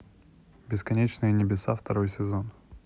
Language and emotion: Russian, neutral